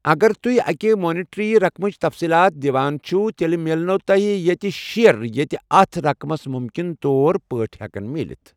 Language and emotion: Kashmiri, neutral